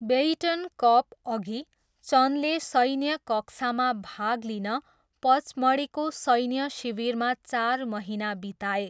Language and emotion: Nepali, neutral